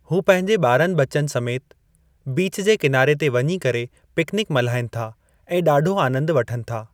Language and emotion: Sindhi, neutral